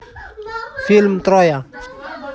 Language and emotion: Russian, neutral